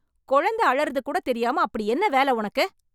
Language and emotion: Tamil, angry